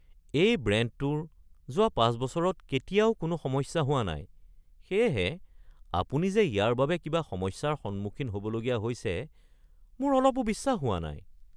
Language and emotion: Assamese, surprised